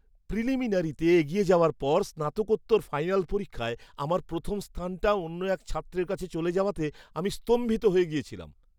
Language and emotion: Bengali, surprised